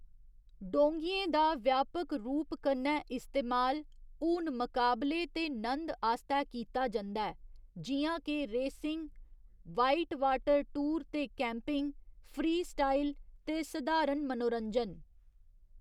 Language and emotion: Dogri, neutral